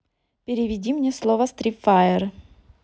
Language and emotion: Russian, neutral